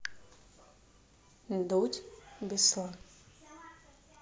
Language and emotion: Russian, neutral